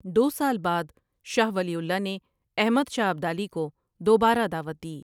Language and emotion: Urdu, neutral